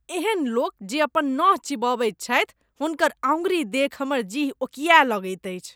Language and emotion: Maithili, disgusted